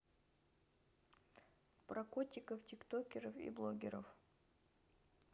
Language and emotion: Russian, neutral